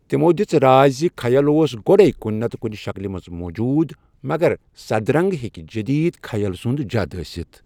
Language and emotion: Kashmiri, neutral